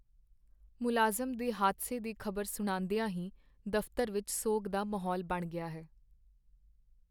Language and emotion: Punjabi, sad